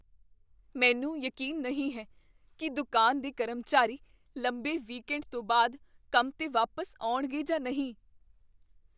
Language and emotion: Punjabi, fearful